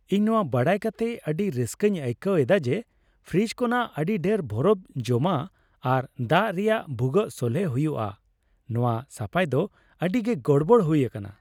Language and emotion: Santali, happy